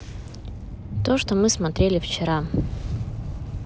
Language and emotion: Russian, neutral